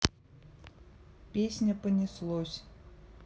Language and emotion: Russian, neutral